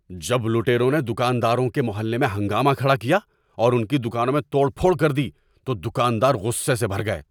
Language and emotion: Urdu, angry